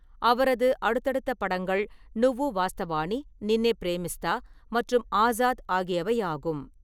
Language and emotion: Tamil, neutral